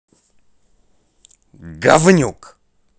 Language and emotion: Russian, angry